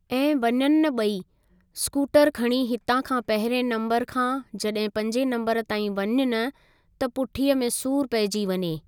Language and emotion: Sindhi, neutral